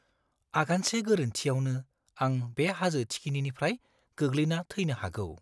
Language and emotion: Bodo, fearful